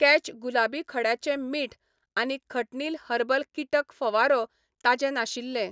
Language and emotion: Goan Konkani, neutral